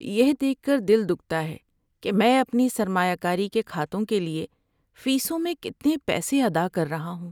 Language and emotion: Urdu, sad